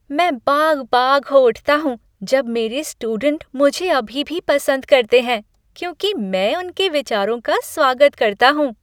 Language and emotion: Hindi, happy